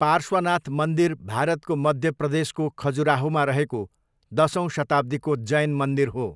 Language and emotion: Nepali, neutral